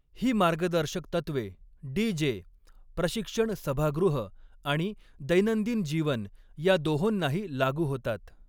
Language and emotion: Marathi, neutral